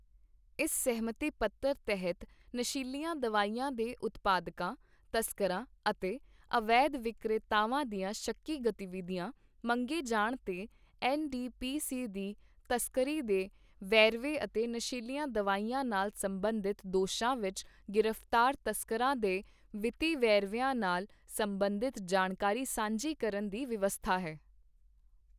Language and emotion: Punjabi, neutral